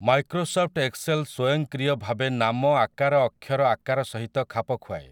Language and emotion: Odia, neutral